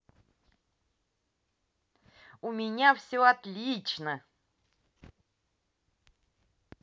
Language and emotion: Russian, positive